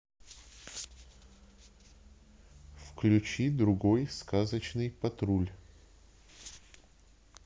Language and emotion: Russian, neutral